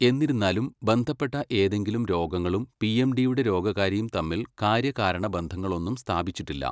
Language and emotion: Malayalam, neutral